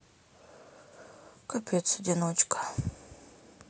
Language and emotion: Russian, sad